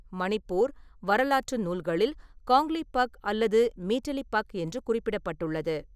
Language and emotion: Tamil, neutral